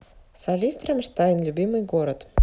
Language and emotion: Russian, neutral